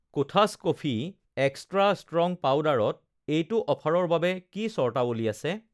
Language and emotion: Assamese, neutral